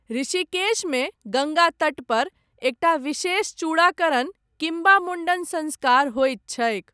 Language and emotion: Maithili, neutral